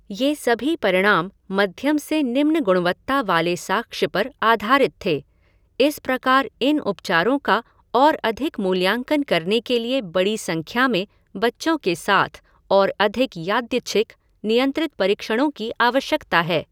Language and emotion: Hindi, neutral